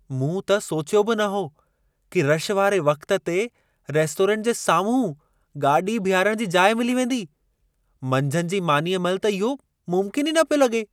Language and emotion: Sindhi, surprised